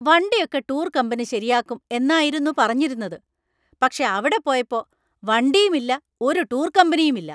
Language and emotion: Malayalam, angry